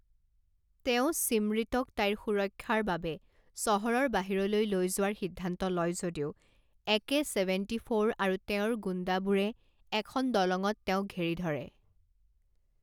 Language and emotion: Assamese, neutral